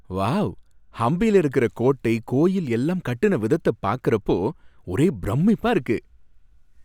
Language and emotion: Tamil, happy